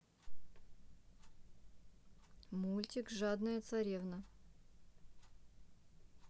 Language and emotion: Russian, neutral